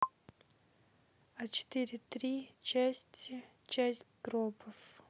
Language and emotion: Russian, neutral